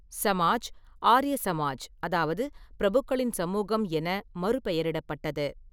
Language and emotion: Tamil, neutral